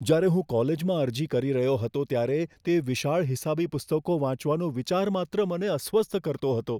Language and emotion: Gujarati, fearful